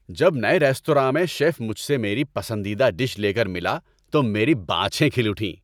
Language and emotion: Urdu, happy